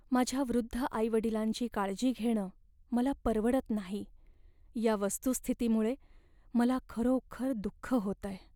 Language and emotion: Marathi, sad